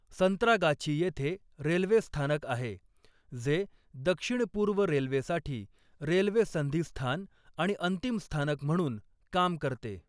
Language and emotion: Marathi, neutral